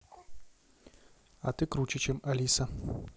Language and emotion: Russian, neutral